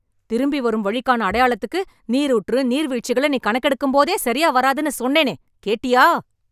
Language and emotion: Tamil, angry